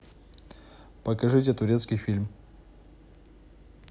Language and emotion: Russian, neutral